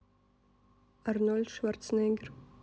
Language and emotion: Russian, neutral